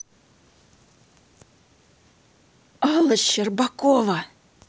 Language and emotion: Russian, angry